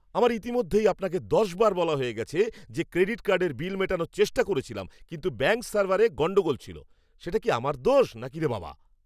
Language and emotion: Bengali, angry